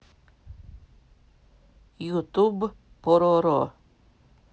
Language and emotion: Russian, neutral